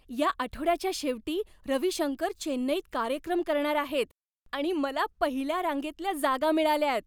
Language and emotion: Marathi, happy